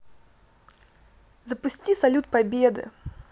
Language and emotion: Russian, positive